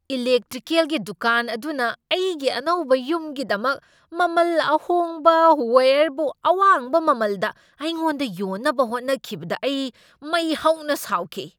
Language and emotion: Manipuri, angry